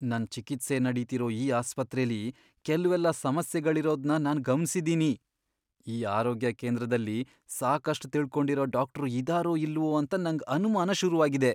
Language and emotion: Kannada, fearful